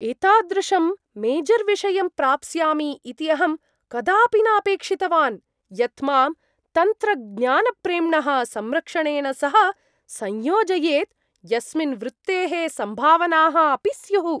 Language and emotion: Sanskrit, surprised